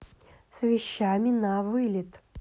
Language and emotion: Russian, neutral